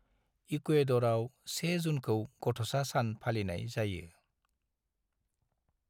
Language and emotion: Bodo, neutral